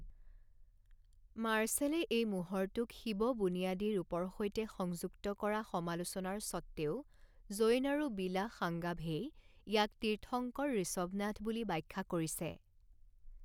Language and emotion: Assamese, neutral